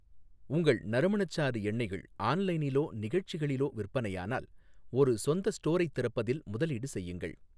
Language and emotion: Tamil, neutral